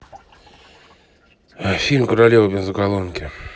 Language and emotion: Russian, neutral